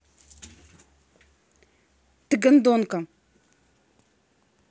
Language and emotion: Russian, angry